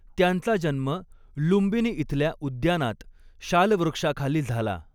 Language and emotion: Marathi, neutral